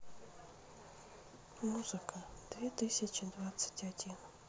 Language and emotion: Russian, sad